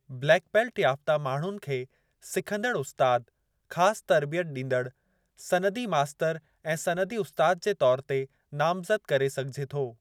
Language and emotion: Sindhi, neutral